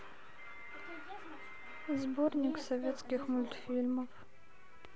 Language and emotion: Russian, sad